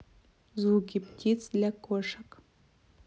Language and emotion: Russian, neutral